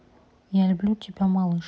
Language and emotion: Russian, neutral